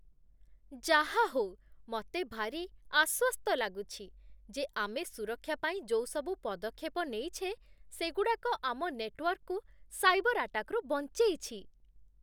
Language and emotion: Odia, happy